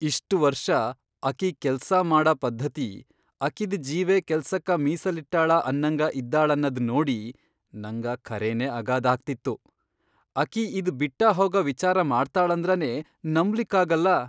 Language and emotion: Kannada, surprised